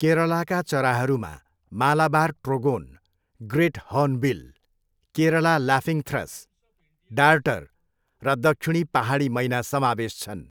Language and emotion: Nepali, neutral